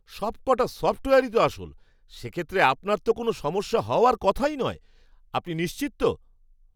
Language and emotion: Bengali, surprised